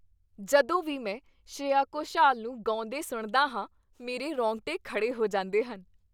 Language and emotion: Punjabi, happy